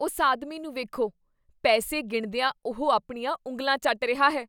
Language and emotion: Punjabi, disgusted